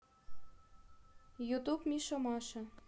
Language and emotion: Russian, neutral